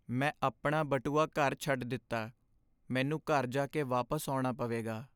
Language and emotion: Punjabi, sad